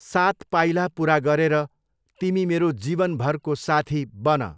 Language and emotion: Nepali, neutral